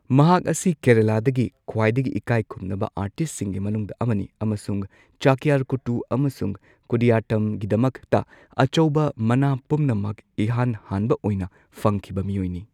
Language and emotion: Manipuri, neutral